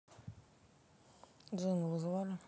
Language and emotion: Russian, neutral